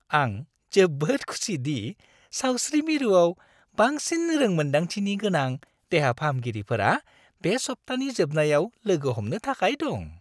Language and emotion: Bodo, happy